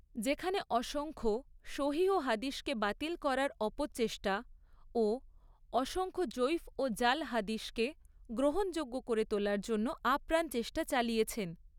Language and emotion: Bengali, neutral